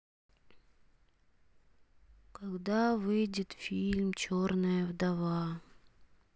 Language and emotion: Russian, sad